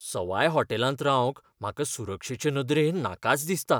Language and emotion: Goan Konkani, fearful